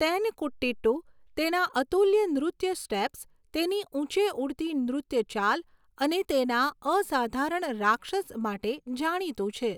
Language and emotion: Gujarati, neutral